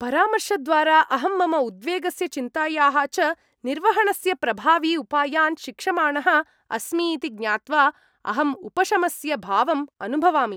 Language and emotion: Sanskrit, happy